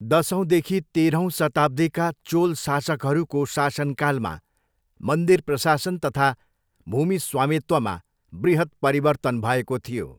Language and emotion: Nepali, neutral